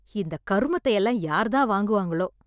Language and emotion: Tamil, disgusted